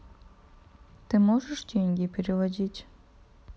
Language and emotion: Russian, neutral